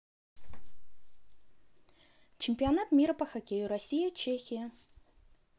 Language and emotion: Russian, neutral